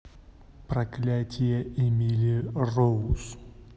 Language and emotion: Russian, neutral